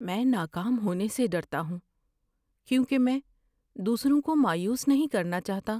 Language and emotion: Urdu, fearful